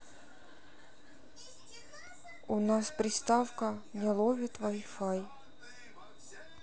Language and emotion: Russian, sad